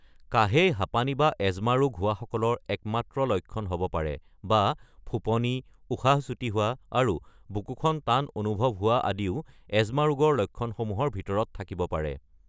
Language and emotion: Assamese, neutral